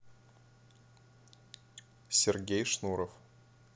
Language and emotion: Russian, neutral